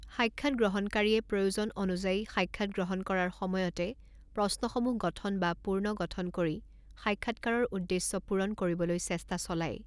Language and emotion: Assamese, neutral